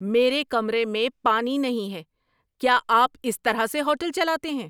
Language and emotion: Urdu, angry